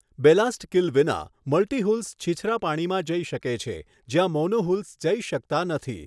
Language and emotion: Gujarati, neutral